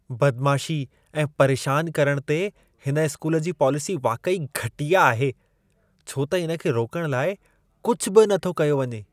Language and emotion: Sindhi, disgusted